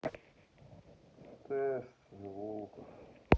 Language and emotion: Russian, neutral